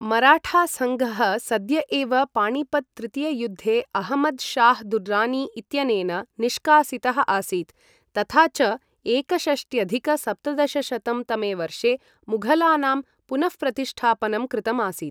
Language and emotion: Sanskrit, neutral